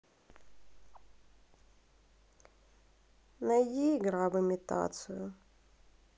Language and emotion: Russian, sad